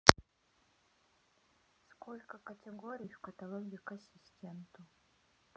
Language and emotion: Russian, neutral